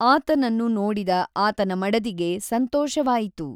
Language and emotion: Kannada, neutral